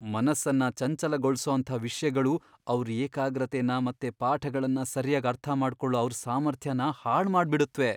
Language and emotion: Kannada, fearful